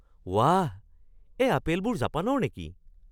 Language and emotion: Assamese, surprised